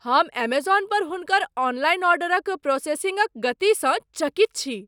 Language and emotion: Maithili, surprised